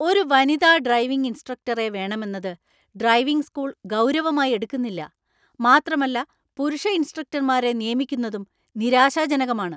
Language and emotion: Malayalam, angry